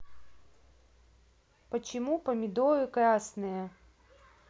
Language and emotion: Russian, neutral